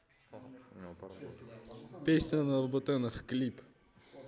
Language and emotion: Russian, positive